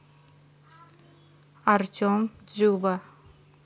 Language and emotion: Russian, neutral